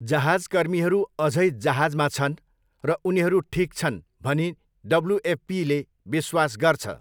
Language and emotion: Nepali, neutral